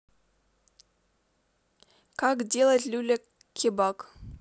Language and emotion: Russian, neutral